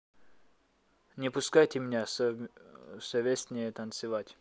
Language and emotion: Russian, neutral